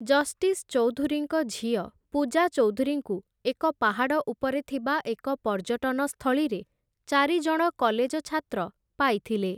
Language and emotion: Odia, neutral